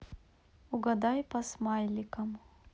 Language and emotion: Russian, neutral